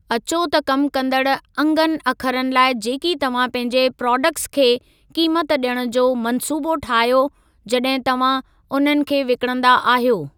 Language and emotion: Sindhi, neutral